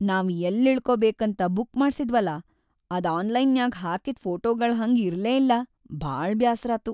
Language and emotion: Kannada, sad